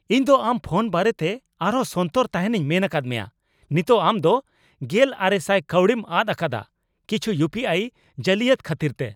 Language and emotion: Santali, angry